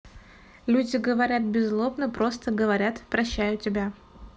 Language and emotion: Russian, neutral